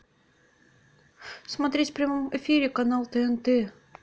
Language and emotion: Russian, neutral